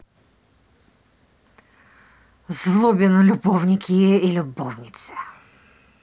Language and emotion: Russian, angry